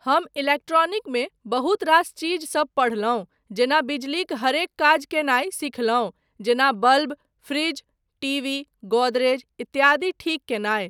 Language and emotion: Maithili, neutral